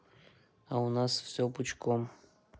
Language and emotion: Russian, neutral